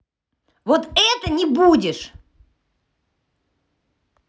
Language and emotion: Russian, angry